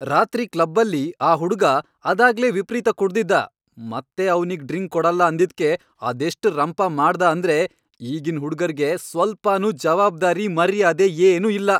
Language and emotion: Kannada, angry